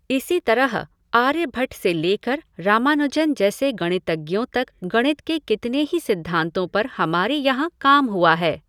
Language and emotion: Hindi, neutral